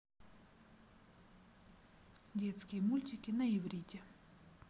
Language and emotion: Russian, neutral